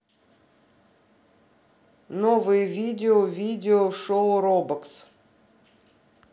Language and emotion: Russian, neutral